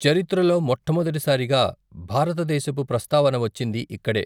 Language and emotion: Telugu, neutral